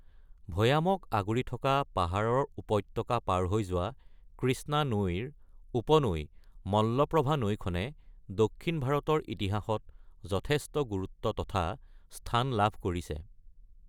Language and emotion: Assamese, neutral